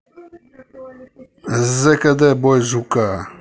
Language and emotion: Russian, angry